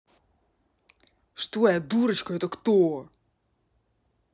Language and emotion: Russian, angry